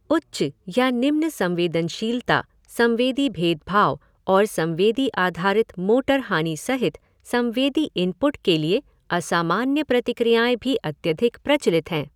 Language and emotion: Hindi, neutral